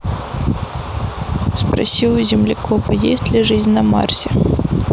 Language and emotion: Russian, neutral